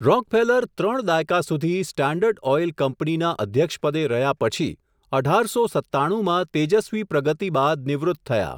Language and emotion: Gujarati, neutral